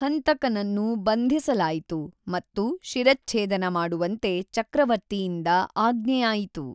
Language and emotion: Kannada, neutral